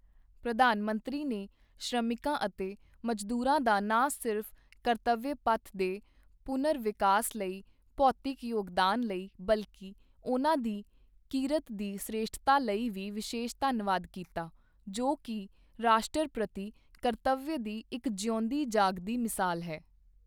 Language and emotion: Punjabi, neutral